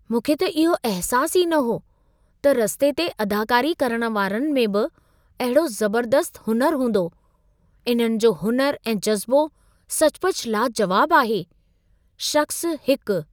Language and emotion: Sindhi, surprised